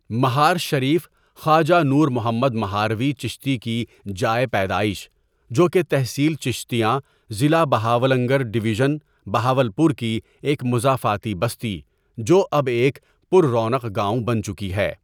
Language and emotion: Urdu, neutral